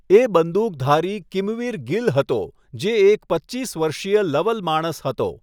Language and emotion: Gujarati, neutral